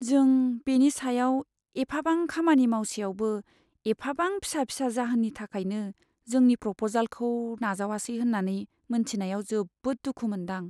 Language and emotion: Bodo, sad